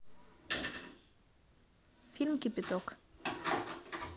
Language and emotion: Russian, neutral